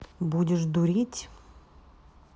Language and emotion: Russian, neutral